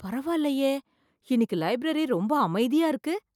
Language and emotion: Tamil, surprised